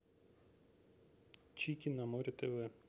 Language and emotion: Russian, neutral